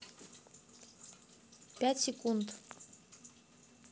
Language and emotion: Russian, neutral